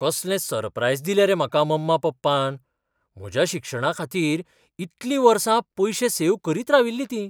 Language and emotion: Goan Konkani, surprised